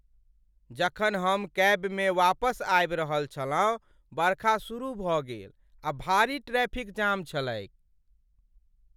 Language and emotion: Maithili, sad